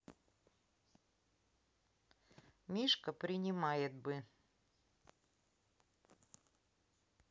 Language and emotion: Russian, neutral